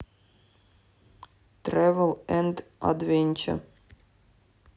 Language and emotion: Russian, neutral